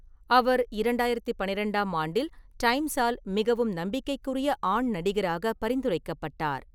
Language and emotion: Tamil, neutral